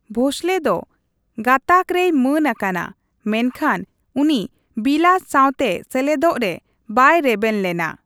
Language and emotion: Santali, neutral